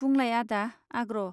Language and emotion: Bodo, neutral